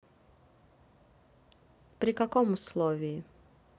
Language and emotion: Russian, neutral